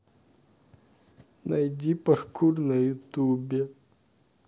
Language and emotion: Russian, sad